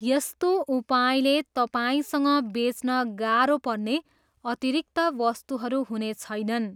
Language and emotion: Nepali, neutral